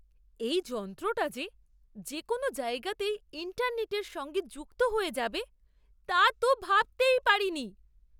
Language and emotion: Bengali, surprised